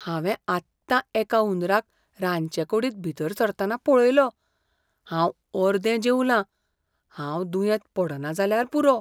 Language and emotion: Goan Konkani, fearful